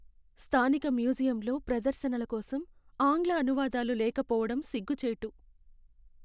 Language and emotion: Telugu, sad